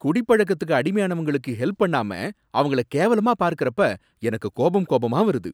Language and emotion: Tamil, angry